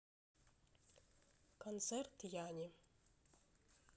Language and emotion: Russian, neutral